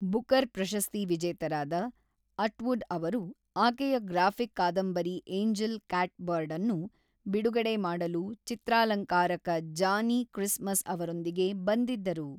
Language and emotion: Kannada, neutral